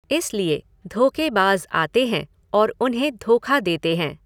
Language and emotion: Hindi, neutral